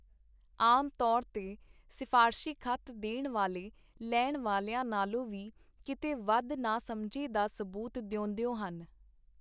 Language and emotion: Punjabi, neutral